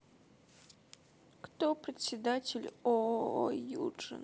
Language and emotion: Russian, sad